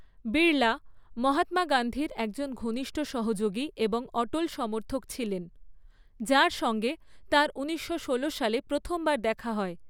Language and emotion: Bengali, neutral